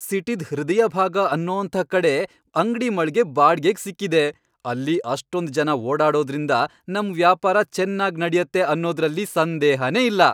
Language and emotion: Kannada, happy